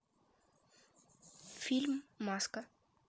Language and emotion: Russian, neutral